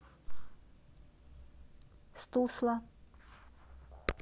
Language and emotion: Russian, neutral